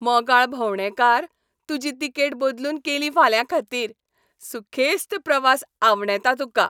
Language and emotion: Goan Konkani, happy